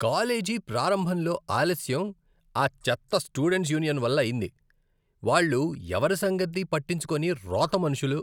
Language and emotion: Telugu, disgusted